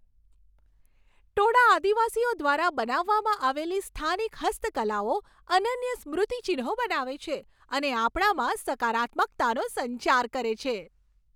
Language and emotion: Gujarati, happy